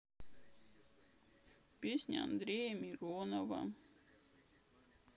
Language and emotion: Russian, sad